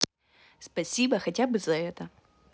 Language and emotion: Russian, neutral